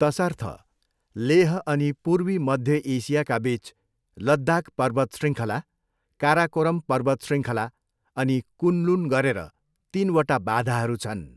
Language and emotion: Nepali, neutral